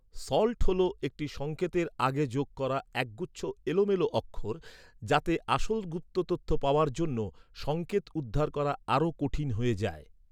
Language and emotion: Bengali, neutral